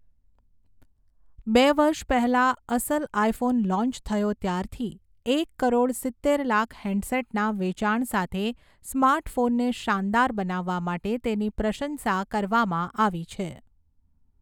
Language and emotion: Gujarati, neutral